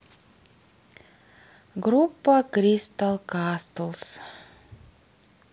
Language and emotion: Russian, neutral